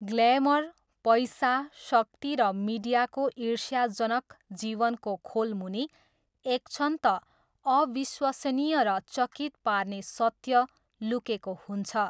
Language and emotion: Nepali, neutral